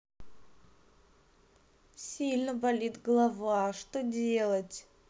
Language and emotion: Russian, sad